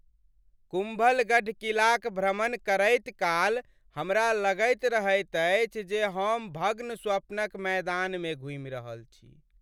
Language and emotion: Maithili, sad